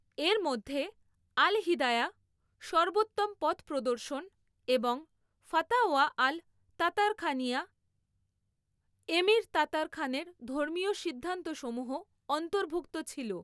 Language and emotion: Bengali, neutral